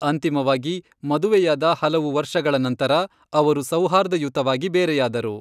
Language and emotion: Kannada, neutral